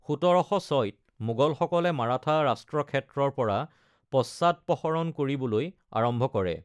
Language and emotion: Assamese, neutral